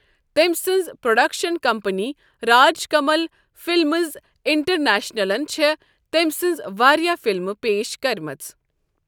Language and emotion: Kashmiri, neutral